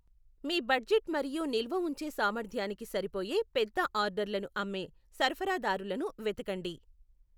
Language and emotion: Telugu, neutral